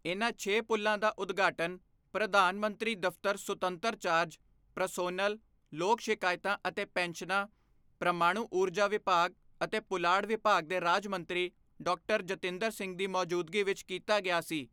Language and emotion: Punjabi, neutral